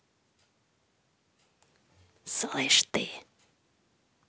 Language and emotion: Russian, angry